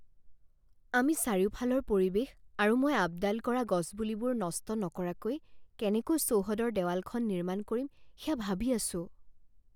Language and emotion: Assamese, fearful